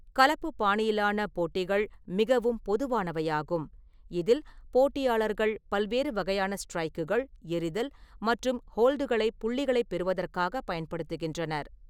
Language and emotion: Tamil, neutral